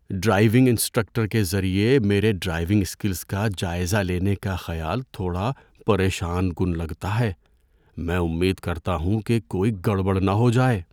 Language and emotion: Urdu, fearful